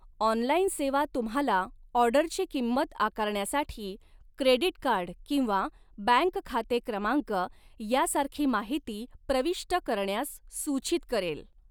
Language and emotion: Marathi, neutral